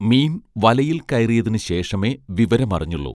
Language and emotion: Malayalam, neutral